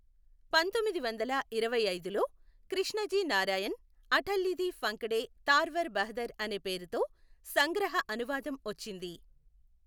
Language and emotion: Telugu, neutral